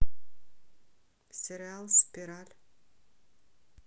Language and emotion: Russian, neutral